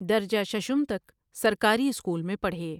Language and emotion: Urdu, neutral